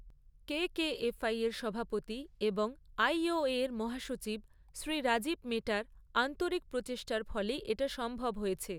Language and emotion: Bengali, neutral